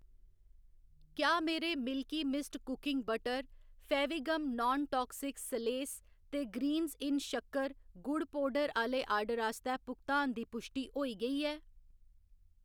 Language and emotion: Dogri, neutral